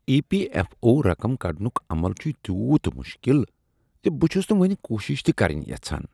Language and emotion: Kashmiri, disgusted